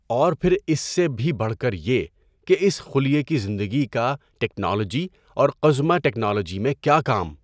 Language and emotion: Urdu, neutral